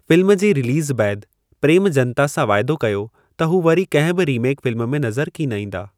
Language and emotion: Sindhi, neutral